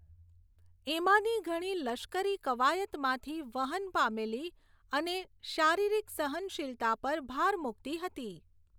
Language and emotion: Gujarati, neutral